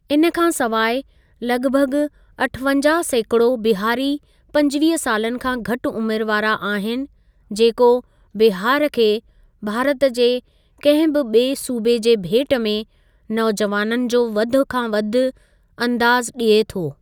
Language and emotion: Sindhi, neutral